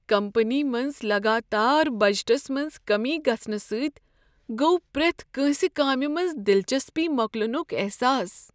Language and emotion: Kashmiri, sad